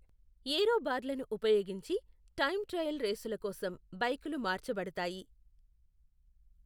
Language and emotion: Telugu, neutral